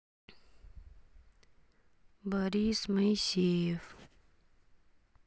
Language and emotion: Russian, sad